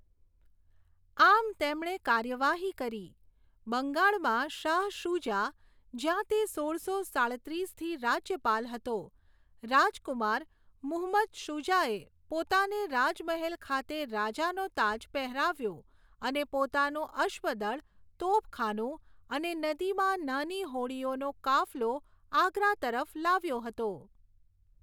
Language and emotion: Gujarati, neutral